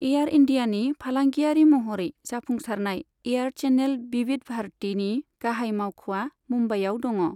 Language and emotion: Bodo, neutral